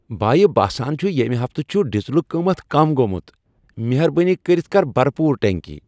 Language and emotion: Kashmiri, happy